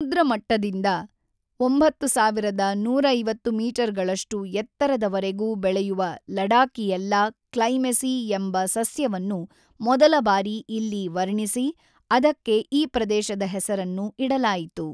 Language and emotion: Kannada, neutral